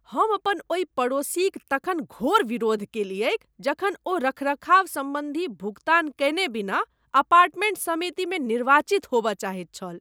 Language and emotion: Maithili, disgusted